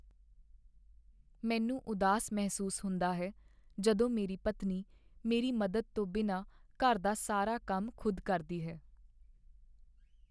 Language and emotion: Punjabi, sad